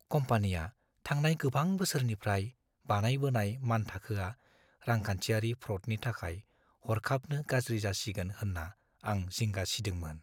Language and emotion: Bodo, fearful